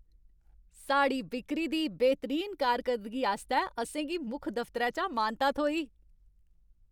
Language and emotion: Dogri, happy